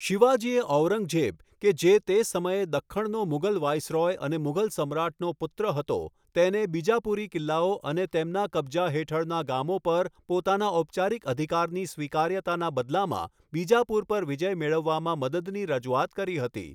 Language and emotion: Gujarati, neutral